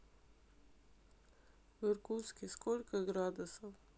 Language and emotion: Russian, sad